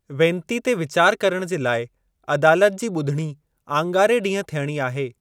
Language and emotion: Sindhi, neutral